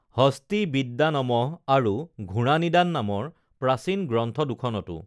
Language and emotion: Assamese, neutral